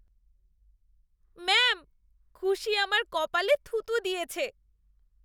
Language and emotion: Bengali, disgusted